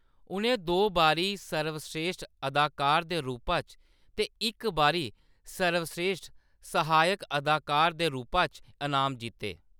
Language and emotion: Dogri, neutral